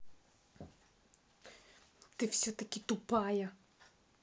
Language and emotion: Russian, angry